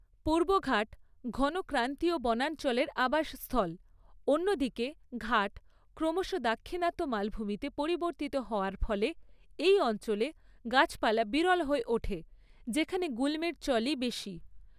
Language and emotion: Bengali, neutral